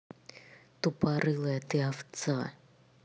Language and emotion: Russian, angry